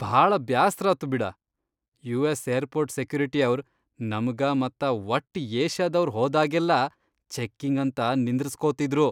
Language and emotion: Kannada, disgusted